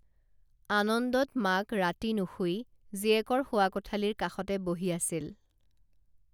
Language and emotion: Assamese, neutral